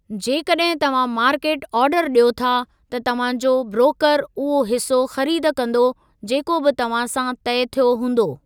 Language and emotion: Sindhi, neutral